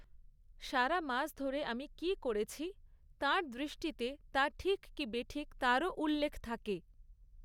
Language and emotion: Bengali, neutral